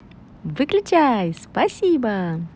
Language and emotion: Russian, positive